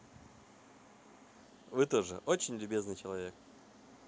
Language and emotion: Russian, positive